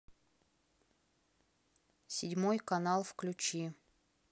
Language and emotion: Russian, neutral